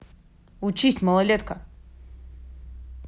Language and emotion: Russian, angry